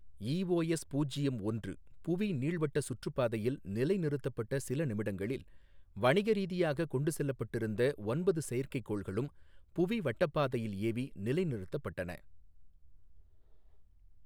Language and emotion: Tamil, neutral